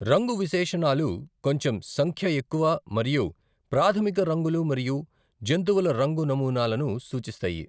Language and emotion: Telugu, neutral